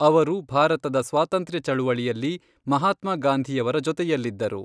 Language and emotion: Kannada, neutral